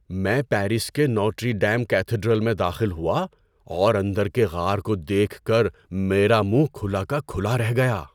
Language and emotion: Urdu, surprised